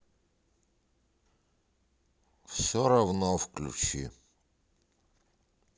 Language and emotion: Russian, sad